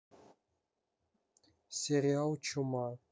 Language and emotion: Russian, neutral